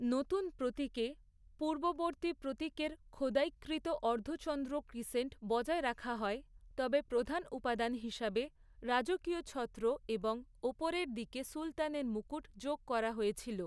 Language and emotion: Bengali, neutral